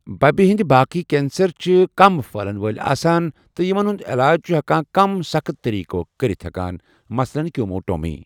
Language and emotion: Kashmiri, neutral